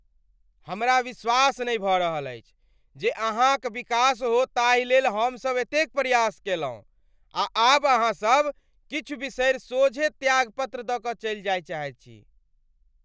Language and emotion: Maithili, angry